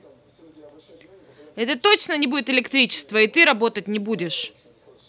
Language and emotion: Russian, angry